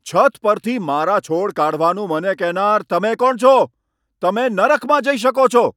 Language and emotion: Gujarati, angry